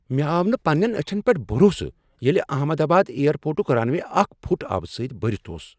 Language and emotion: Kashmiri, surprised